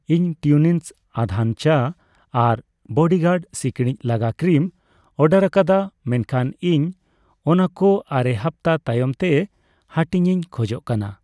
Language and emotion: Santali, neutral